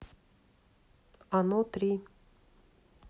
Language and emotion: Russian, neutral